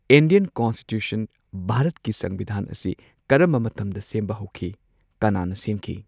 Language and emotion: Manipuri, neutral